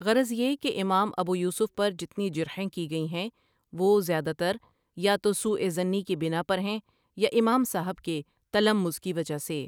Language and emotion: Urdu, neutral